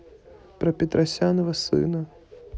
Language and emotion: Russian, neutral